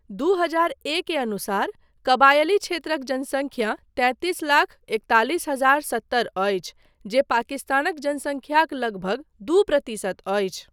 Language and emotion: Maithili, neutral